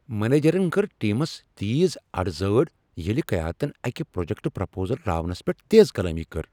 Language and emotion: Kashmiri, angry